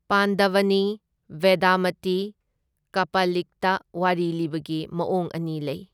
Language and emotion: Manipuri, neutral